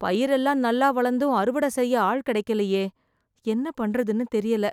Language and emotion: Tamil, fearful